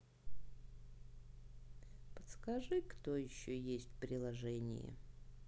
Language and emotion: Russian, neutral